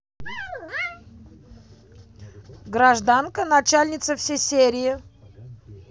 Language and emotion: Russian, positive